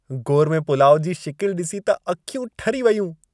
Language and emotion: Sindhi, happy